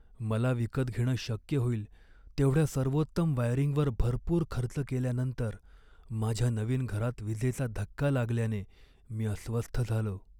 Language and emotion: Marathi, sad